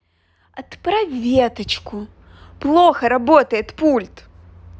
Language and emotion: Russian, angry